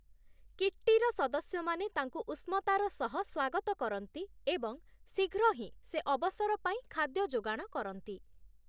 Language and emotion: Odia, neutral